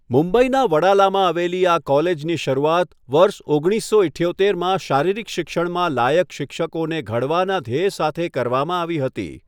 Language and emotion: Gujarati, neutral